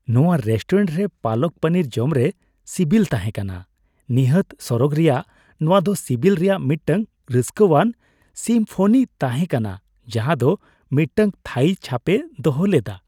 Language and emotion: Santali, happy